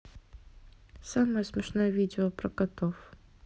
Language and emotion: Russian, neutral